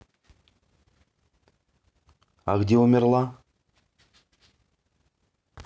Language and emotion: Russian, neutral